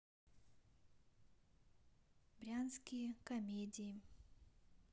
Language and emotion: Russian, sad